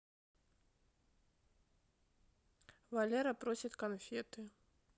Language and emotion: Russian, neutral